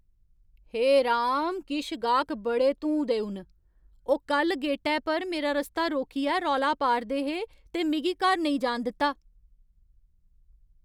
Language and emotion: Dogri, angry